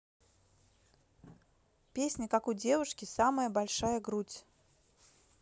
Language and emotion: Russian, neutral